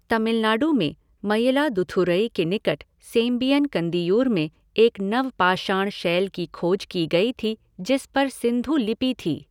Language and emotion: Hindi, neutral